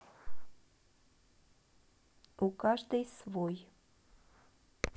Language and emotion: Russian, neutral